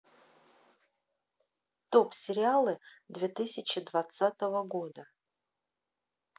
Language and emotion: Russian, neutral